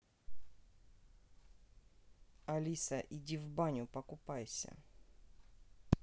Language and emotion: Russian, neutral